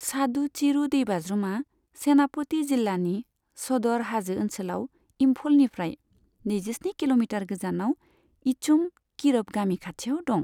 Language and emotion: Bodo, neutral